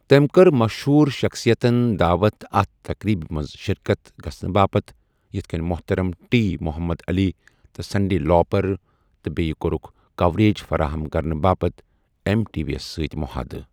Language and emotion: Kashmiri, neutral